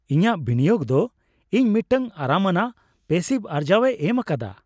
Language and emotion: Santali, happy